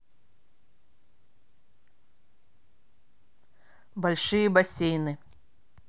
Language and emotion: Russian, neutral